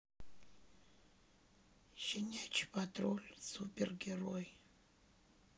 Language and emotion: Russian, sad